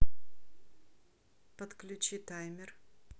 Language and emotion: Russian, neutral